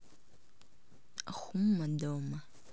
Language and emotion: Russian, neutral